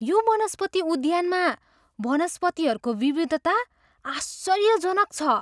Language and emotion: Nepali, surprised